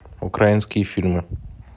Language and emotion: Russian, neutral